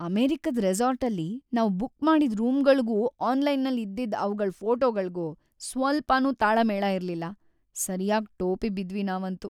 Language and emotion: Kannada, sad